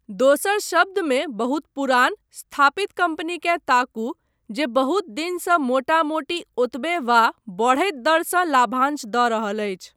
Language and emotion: Maithili, neutral